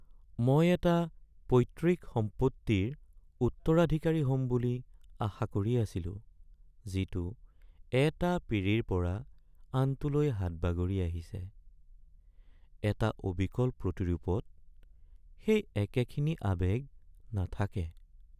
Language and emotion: Assamese, sad